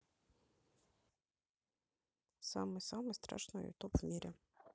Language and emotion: Russian, neutral